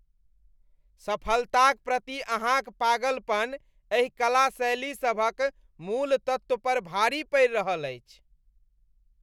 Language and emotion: Maithili, disgusted